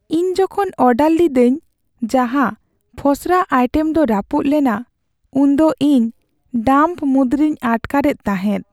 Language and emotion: Santali, sad